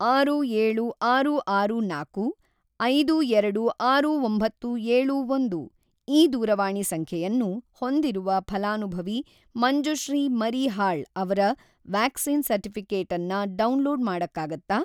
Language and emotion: Kannada, neutral